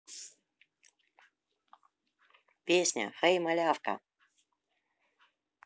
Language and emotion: Russian, positive